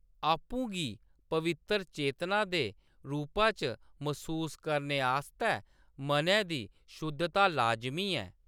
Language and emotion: Dogri, neutral